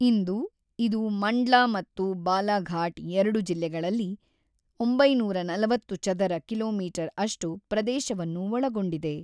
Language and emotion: Kannada, neutral